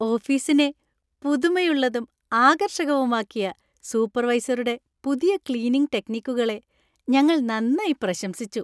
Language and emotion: Malayalam, happy